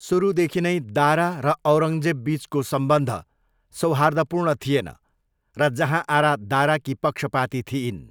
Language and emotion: Nepali, neutral